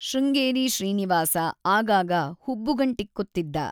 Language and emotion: Kannada, neutral